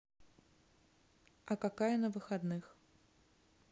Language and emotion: Russian, neutral